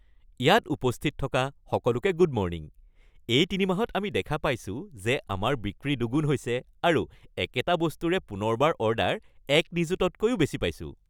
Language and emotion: Assamese, happy